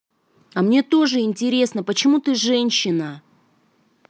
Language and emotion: Russian, angry